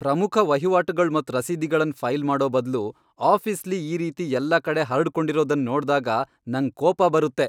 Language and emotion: Kannada, angry